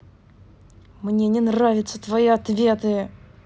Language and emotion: Russian, angry